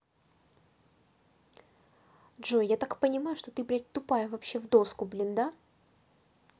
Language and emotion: Russian, angry